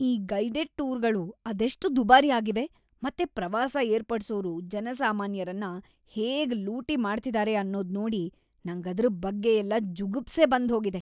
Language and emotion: Kannada, disgusted